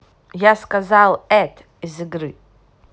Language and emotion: Russian, angry